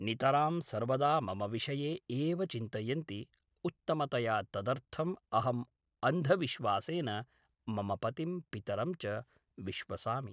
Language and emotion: Sanskrit, neutral